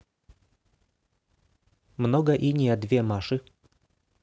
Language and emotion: Russian, neutral